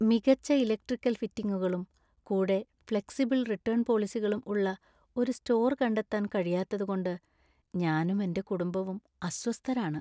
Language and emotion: Malayalam, sad